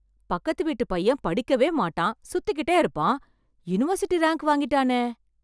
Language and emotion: Tamil, surprised